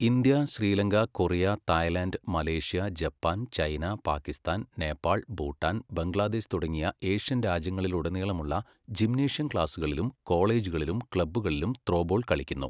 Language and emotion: Malayalam, neutral